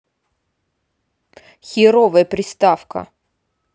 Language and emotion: Russian, angry